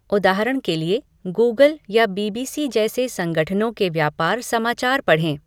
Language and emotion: Hindi, neutral